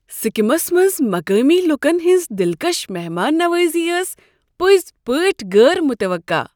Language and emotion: Kashmiri, surprised